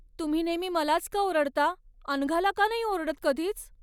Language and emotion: Marathi, sad